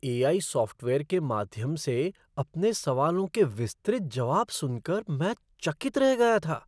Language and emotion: Hindi, surprised